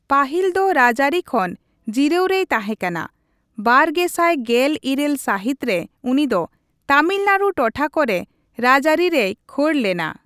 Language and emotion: Santali, neutral